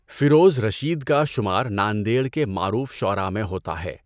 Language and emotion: Urdu, neutral